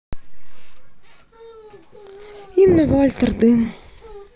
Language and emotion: Russian, sad